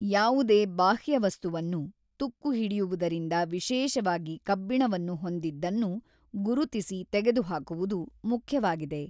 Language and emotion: Kannada, neutral